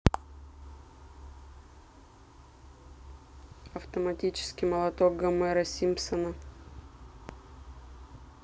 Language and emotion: Russian, neutral